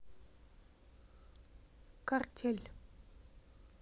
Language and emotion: Russian, neutral